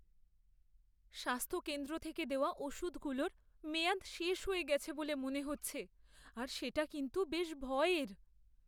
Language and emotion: Bengali, fearful